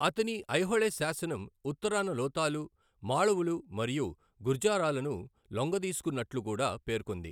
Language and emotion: Telugu, neutral